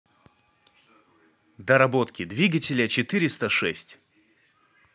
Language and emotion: Russian, neutral